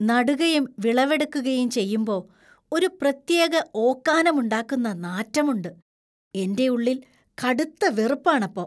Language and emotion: Malayalam, disgusted